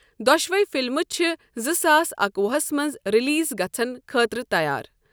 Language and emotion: Kashmiri, neutral